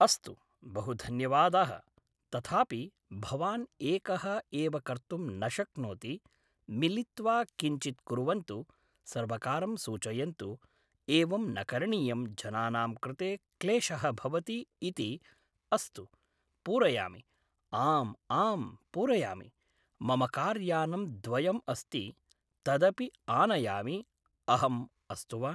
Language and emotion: Sanskrit, neutral